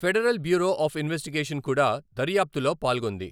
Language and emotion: Telugu, neutral